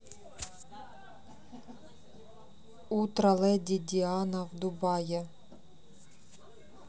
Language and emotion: Russian, neutral